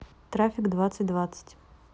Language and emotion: Russian, neutral